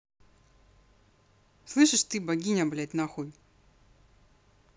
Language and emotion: Russian, angry